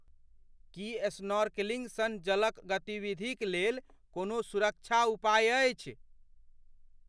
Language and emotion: Maithili, fearful